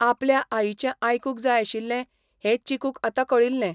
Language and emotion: Goan Konkani, neutral